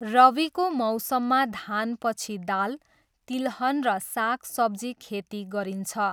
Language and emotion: Nepali, neutral